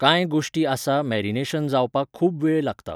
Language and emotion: Goan Konkani, neutral